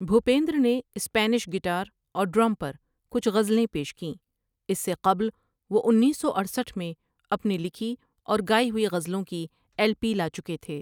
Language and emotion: Urdu, neutral